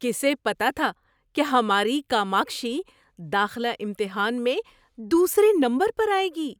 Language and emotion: Urdu, surprised